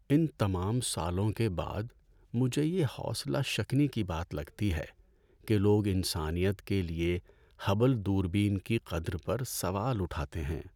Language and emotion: Urdu, sad